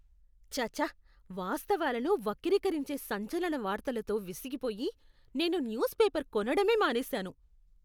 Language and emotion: Telugu, disgusted